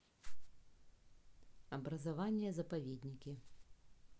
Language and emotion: Russian, neutral